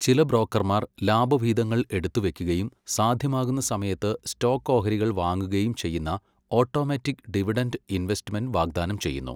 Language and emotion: Malayalam, neutral